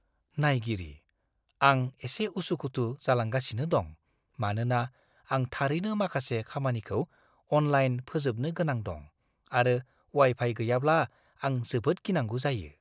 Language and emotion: Bodo, fearful